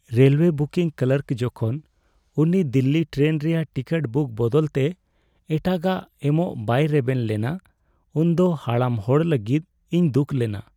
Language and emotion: Santali, sad